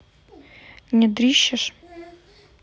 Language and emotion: Russian, neutral